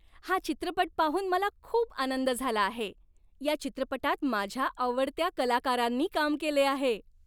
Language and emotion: Marathi, happy